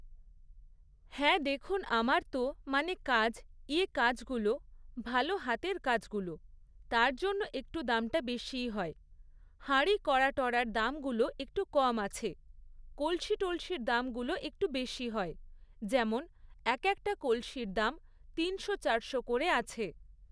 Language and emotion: Bengali, neutral